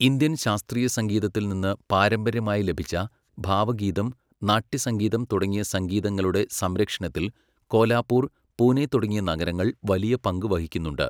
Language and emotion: Malayalam, neutral